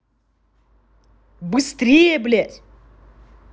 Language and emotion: Russian, angry